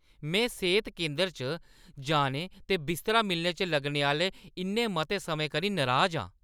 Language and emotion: Dogri, angry